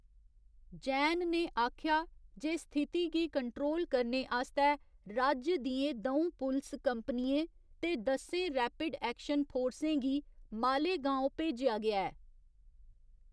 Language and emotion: Dogri, neutral